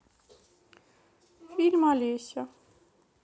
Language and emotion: Russian, sad